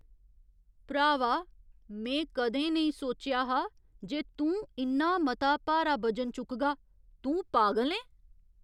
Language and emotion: Dogri, surprised